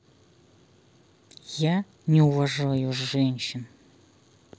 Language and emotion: Russian, angry